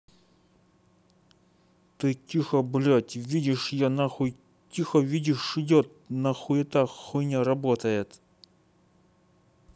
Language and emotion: Russian, angry